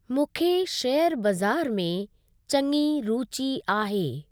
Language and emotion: Sindhi, neutral